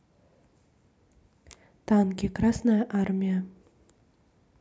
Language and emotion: Russian, neutral